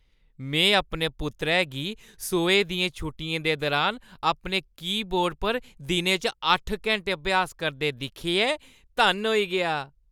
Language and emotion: Dogri, happy